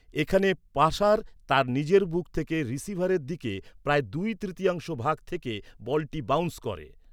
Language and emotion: Bengali, neutral